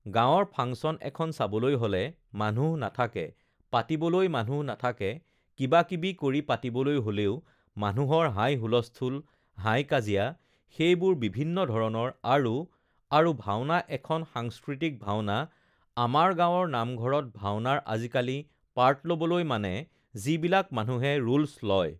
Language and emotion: Assamese, neutral